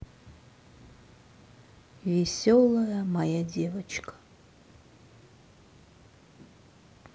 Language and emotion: Russian, sad